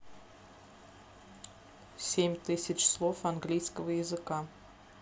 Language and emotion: Russian, neutral